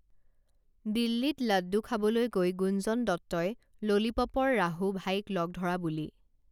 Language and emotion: Assamese, neutral